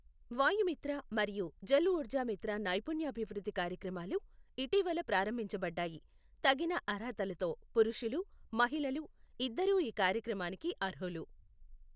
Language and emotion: Telugu, neutral